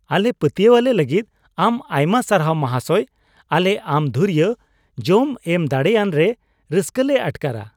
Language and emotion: Santali, happy